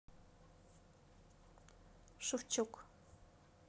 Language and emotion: Russian, neutral